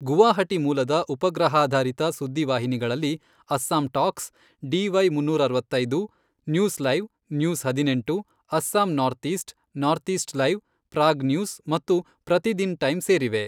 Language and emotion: Kannada, neutral